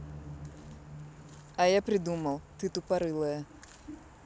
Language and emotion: Russian, neutral